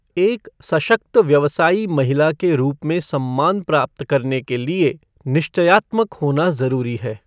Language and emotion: Hindi, neutral